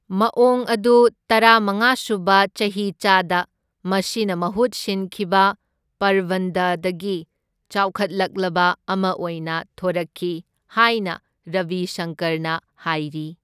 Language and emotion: Manipuri, neutral